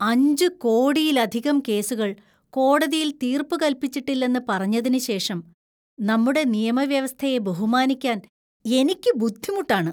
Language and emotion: Malayalam, disgusted